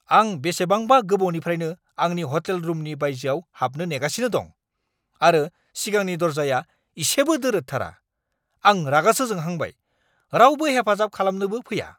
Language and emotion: Bodo, angry